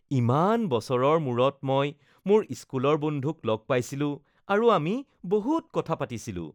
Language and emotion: Assamese, happy